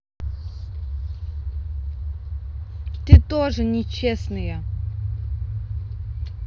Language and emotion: Russian, angry